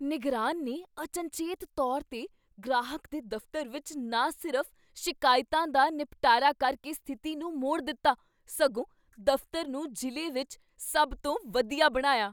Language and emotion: Punjabi, surprised